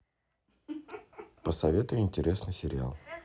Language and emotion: Russian, positive